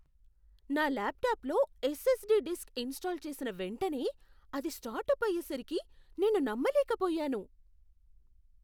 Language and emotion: Telugu, surprised